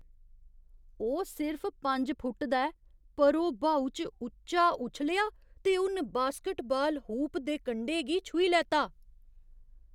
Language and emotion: Dogri, surprised